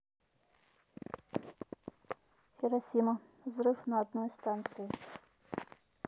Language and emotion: Russian, neutral